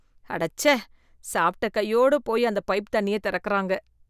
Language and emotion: Tamil, disgusted